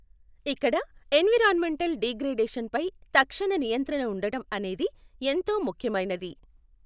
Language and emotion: Telugu, neutral